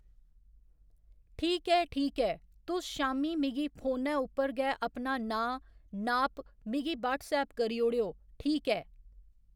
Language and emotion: Dogri, neutral